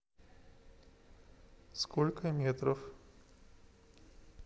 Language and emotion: Russian, neutral